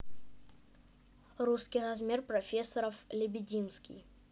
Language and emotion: Russian, neutral